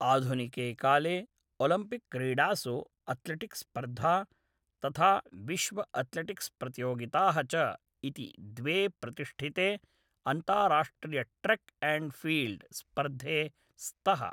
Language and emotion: Sanskrit, neutral